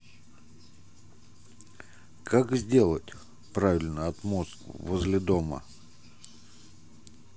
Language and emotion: Russian, neutral